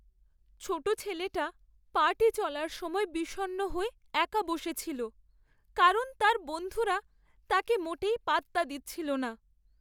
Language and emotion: Bengali, sad